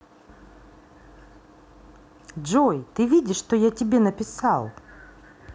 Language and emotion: Russian, positive